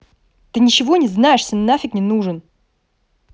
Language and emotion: Russian, angry